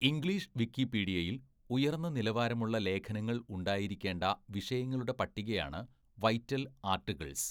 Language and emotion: Malayalam, neutral